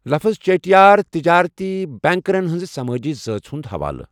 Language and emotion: Kashmiri, neutral